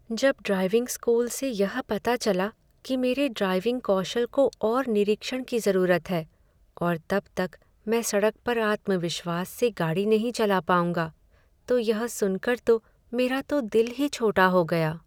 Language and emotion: Hindi, sad